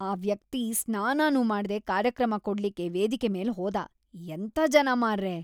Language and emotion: Kannada, disgusted